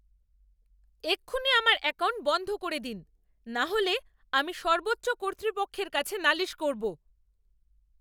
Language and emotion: Bengali, angry